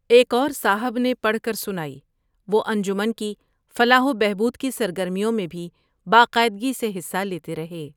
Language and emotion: Urdu, neutral